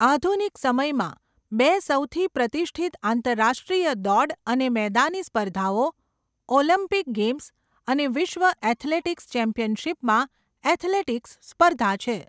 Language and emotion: Gujarati, neutral